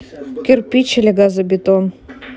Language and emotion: Russian, neutral